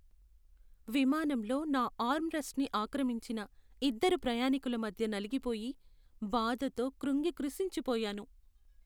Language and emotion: Telugu, sad